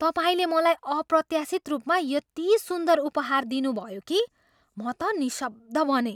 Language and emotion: Nepali, surprised